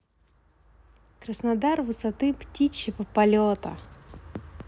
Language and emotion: Russian, positive